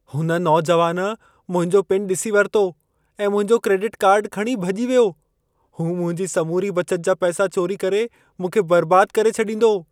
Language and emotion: Sindhi, fearful